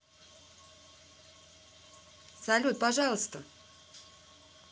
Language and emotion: Russian, positive